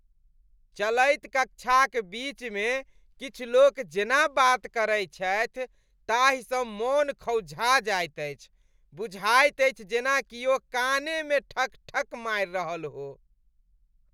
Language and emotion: Maithili, disgusted